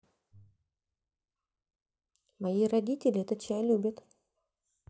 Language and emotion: Russian, neutral